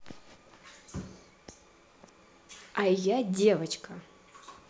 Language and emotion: Russian, neutral